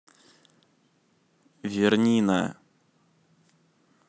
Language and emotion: Russian, neutral